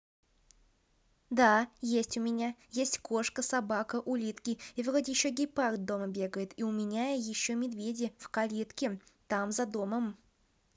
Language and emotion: Russian, positive